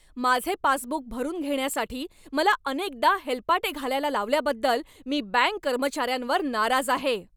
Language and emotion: Marathi, angry